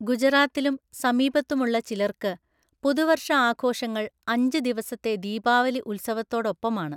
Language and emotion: Malayalam, neutral